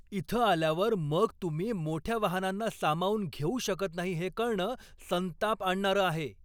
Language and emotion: Marathi, angry